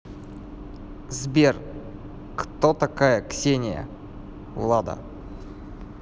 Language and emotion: Russian, neutral